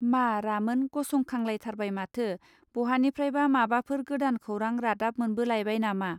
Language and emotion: Bodo, neutral